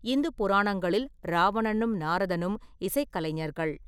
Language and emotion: Tamil, neutral